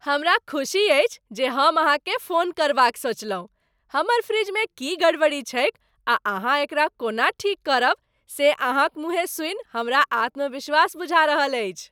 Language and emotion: Maithili, happy